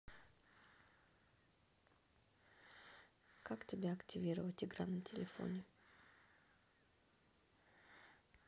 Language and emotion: Russian, neutral